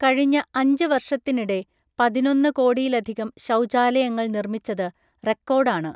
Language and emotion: Malayalam, neutral